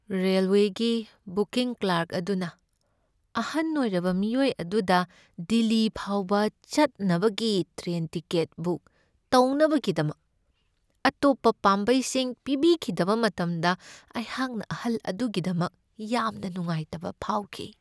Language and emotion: Manipuri, sad